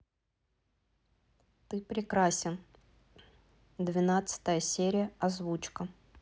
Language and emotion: Russian, neutral